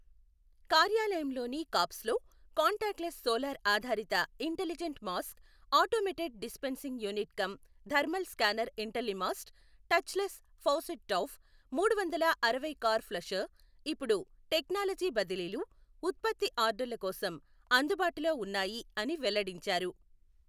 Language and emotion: Telugu, neutral